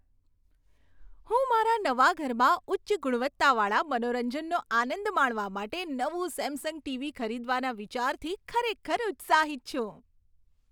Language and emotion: Gujarati, happy